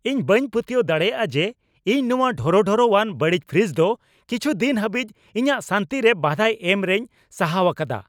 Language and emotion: Santali, angry